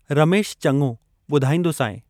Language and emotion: Sindhi, neutral